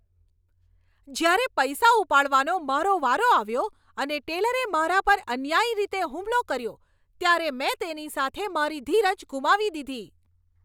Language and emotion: Gujarati, angry